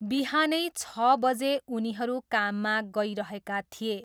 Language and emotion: Nepali, neutral